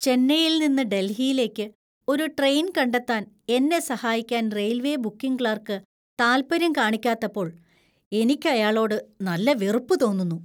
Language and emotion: Malayalam, disgusted